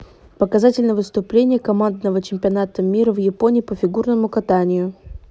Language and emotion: Russian, neutral